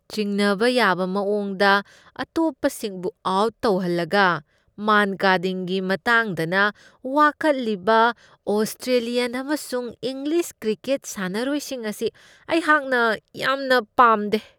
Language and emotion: Manipuri, disgusted